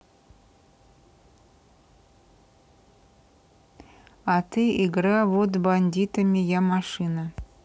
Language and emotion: Russian, neutral